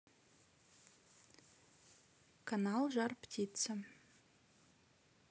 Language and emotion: Russian, neutral